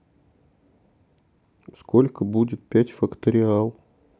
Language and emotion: Russian, neutral